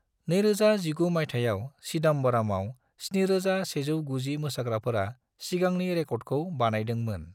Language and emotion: Bodo, neutral